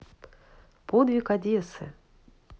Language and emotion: Russian, neutral